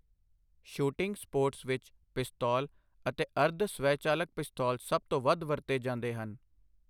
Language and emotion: Punjabi, neutral